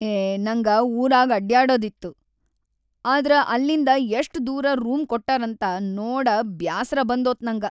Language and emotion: Kannada, sad